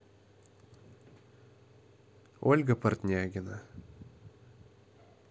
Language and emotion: Russian, neutral